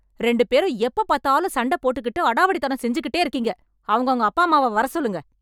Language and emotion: Tamil, angry